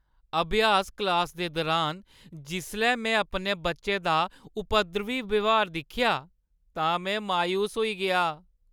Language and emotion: Dogri, sad